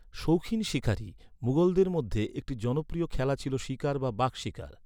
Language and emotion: Bengali, neutral